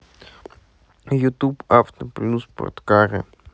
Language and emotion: Russian, sad